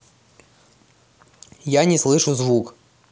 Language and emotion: Russian, neutral